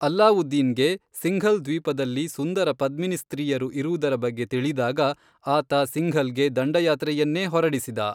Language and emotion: Kannada, neutral